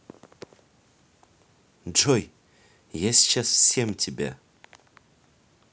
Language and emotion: Russian, neutral